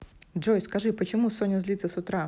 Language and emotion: Russian, neutral